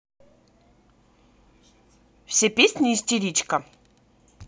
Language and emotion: Russian, neutral